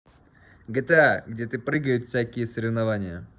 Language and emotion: Russian, neutral